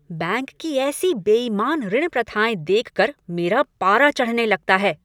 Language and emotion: Hindi, angry